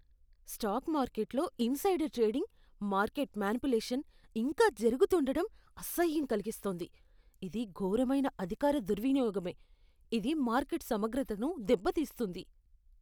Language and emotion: Telugu, disgusted